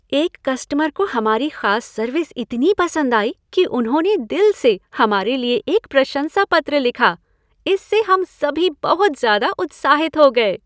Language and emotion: Hindi, happy